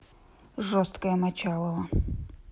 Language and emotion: Russian, neutral